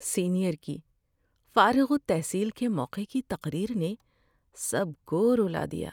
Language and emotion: Urdu, sad